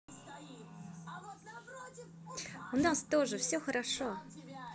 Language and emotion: Russian, positive